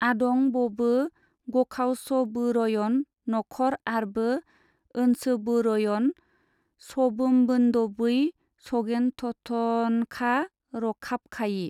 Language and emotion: Bodo, neutral